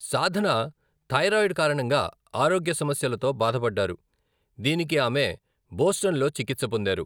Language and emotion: Telugu, neutral